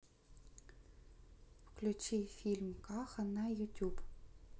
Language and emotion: Russian, neutral